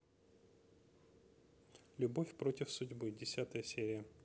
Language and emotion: Russian, neutral